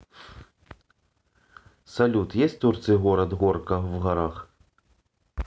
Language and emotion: Russian, neutral